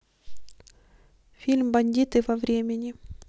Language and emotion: Russian, neutral